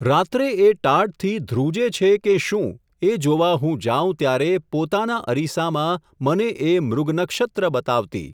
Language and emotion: Gujarati, neutral